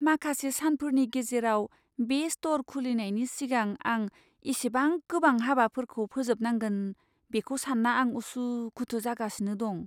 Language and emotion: Bodo, fearful